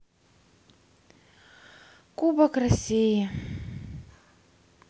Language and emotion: Russian, sad